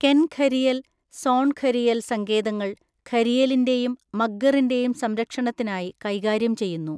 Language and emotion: Malayalam, neutral